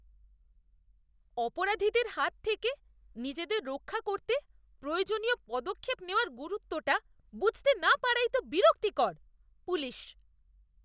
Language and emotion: Bengali, disgusted